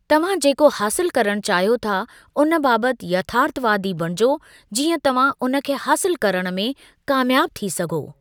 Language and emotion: Sindhi, neutral